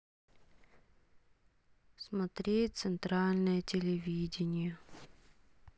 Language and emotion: Russian, sad